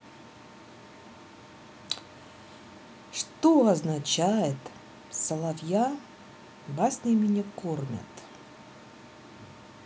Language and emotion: Russian, neutral